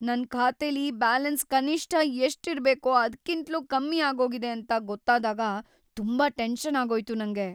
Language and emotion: Kannada, fearful